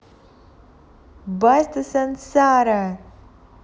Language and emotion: Russian, positive